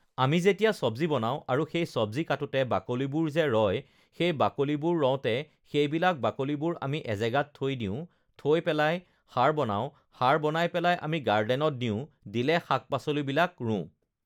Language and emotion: Assamese, neutral